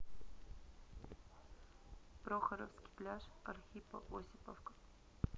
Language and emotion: Russian, neutral